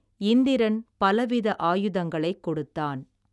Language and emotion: Tamil, neutral